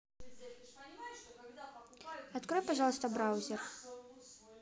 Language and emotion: Russian, neutral